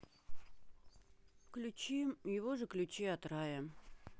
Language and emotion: Russian, sad